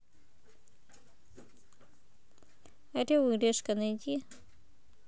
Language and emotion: Russian, neutral